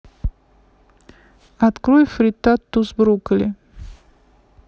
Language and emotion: Russian, neutral